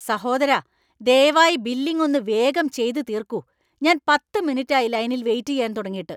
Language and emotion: Malayalam, angry